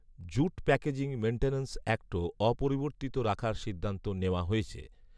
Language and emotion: Bengali, neutral